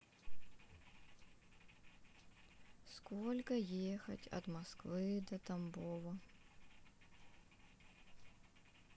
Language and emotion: Russian, sad